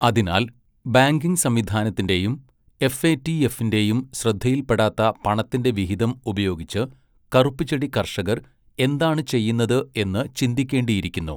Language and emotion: Malayalam, neutral